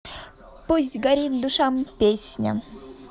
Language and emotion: Russian, positive